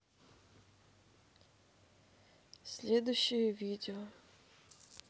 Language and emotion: Russian, sad